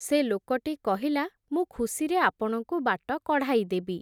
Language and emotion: Odia, neutral